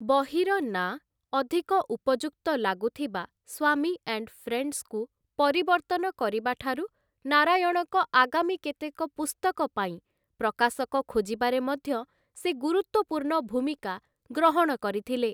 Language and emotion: Odia, neutral